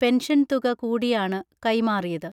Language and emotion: Malayalam, neutral